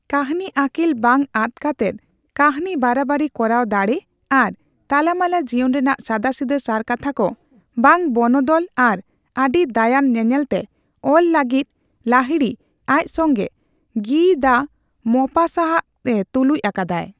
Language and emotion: Santali, neutral